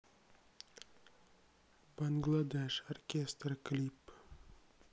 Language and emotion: Russian, neutral